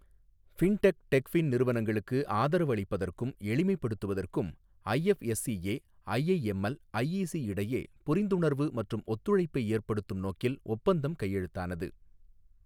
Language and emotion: Tamil, neutral